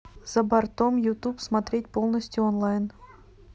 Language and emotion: Russian, neutral